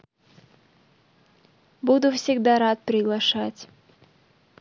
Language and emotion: Russian, neutral